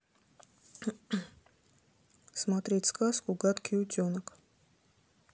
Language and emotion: Russian, neutral